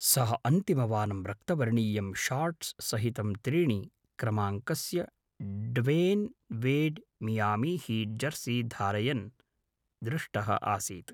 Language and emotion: Sanskrit, neutral